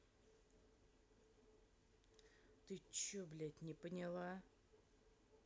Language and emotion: Russian, angry